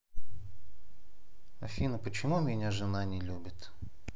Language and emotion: Russian, sad